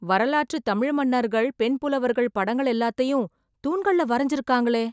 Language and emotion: Tamil, surprised